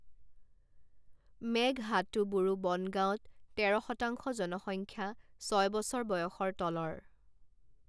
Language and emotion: Assamese, neutral